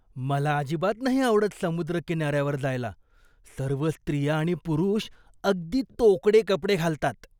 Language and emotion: Marathi, disgusted